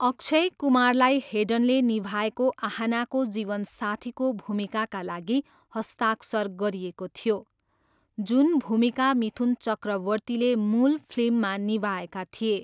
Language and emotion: Nepali, neutral